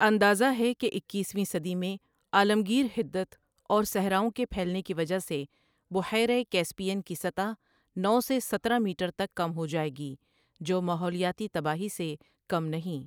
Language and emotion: Urdu, neutral